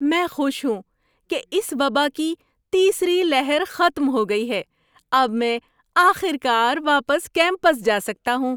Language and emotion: Urdu, happy